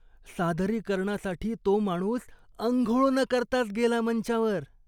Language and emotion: Marathi, disgusted